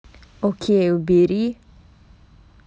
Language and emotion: Russian, angry